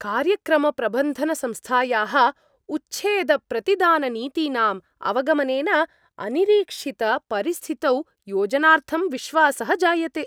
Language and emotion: Sanskrit, happy